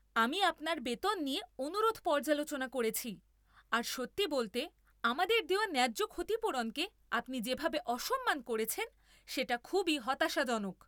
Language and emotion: Bengali, angry